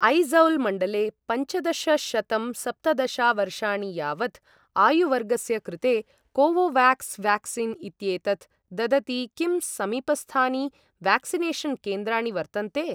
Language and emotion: Sanskrit, neutral